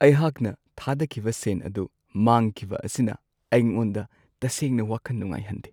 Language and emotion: Manipuri, sad